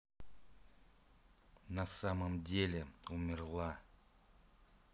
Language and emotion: Russian, neutral